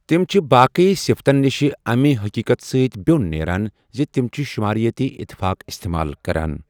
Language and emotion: Kashmiri, neutral